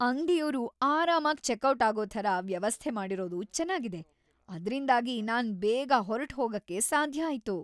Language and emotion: Kannada, happy